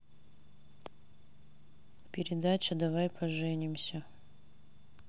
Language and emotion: Russian, neutral